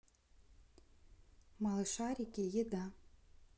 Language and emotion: Russian, neutral